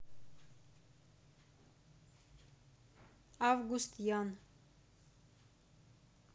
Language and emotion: Russian, neutral